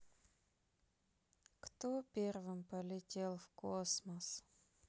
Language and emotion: Russian, sad